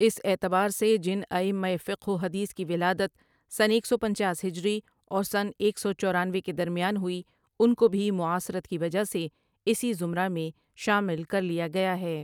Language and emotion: Urdu, neutral